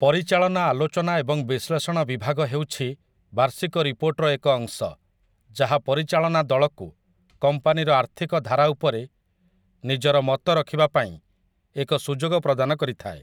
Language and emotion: Odia, neutral